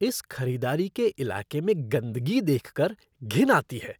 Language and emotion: Hindi, disgusted